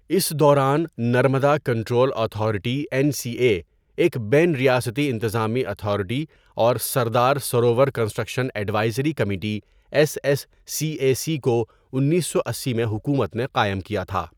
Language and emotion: Urdu, neutral